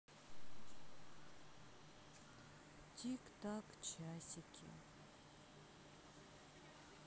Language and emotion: Russian, sad